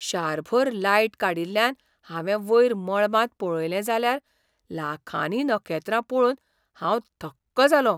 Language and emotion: Goan Konkani, surprised